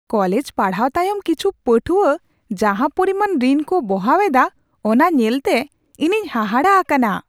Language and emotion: Santali, surprised